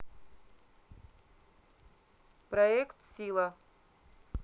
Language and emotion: Russian, neutral